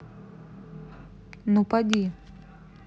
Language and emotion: Russian, neutral